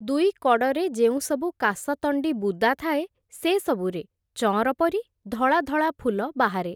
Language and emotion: Odia, neutral